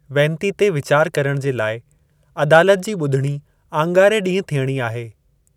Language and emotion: Sindhi, neutral